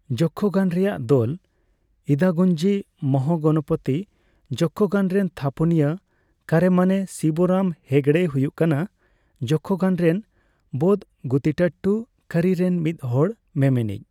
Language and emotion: Santali, neutral